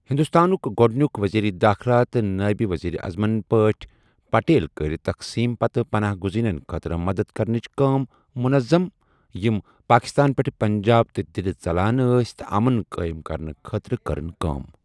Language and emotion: Kashmiri, neutral